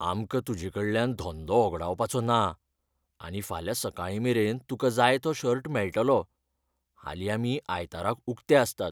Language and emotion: Goan Konkani, fearful